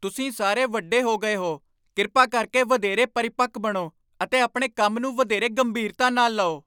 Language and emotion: Punjabi, angry